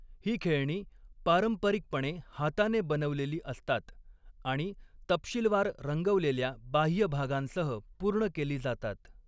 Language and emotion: Marathi, neutral